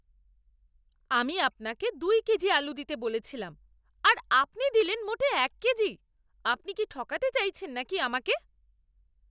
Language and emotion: Bengali, angry